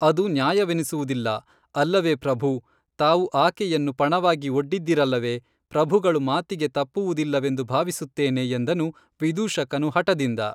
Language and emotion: Kannada, neutral